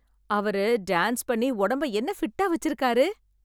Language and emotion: Tamil, happy